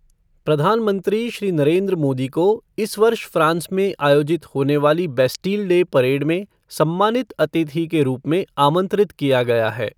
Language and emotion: Hindi, neutral